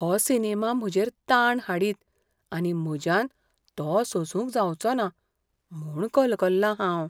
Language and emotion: Goan Konkani, fearful